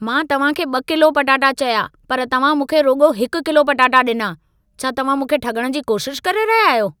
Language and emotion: Sindhi, angry